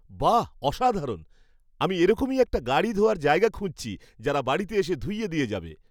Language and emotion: Bengali, happy